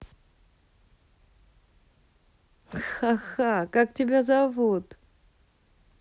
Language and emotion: Russian, positive